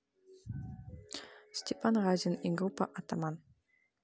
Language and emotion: Russian, neutral